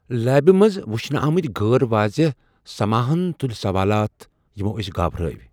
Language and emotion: Kashmiri, fearful